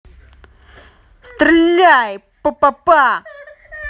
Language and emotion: Russian, angry